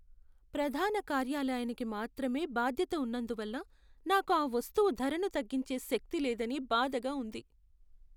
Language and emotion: Telugu, sad